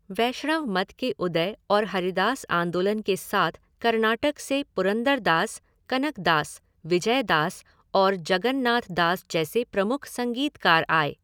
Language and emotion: Hindi, neutral